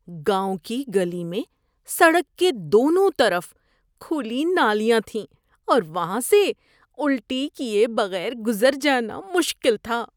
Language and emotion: Urdu, disgusted